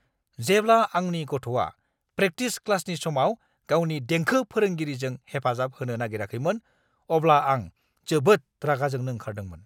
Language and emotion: Bodo, angry